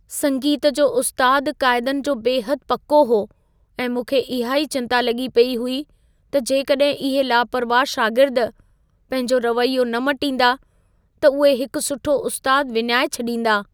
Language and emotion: Sindhi, fearful